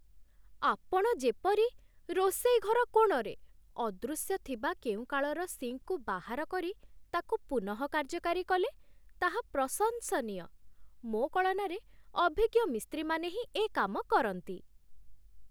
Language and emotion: Odia, surprised